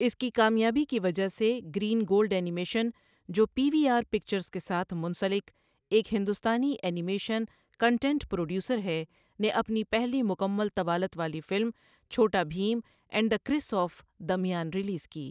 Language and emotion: Urdu, neutral